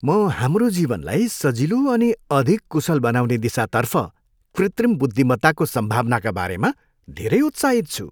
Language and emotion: Nepali, happy